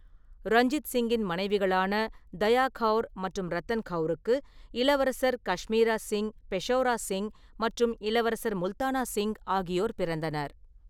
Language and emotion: Tamil, neutral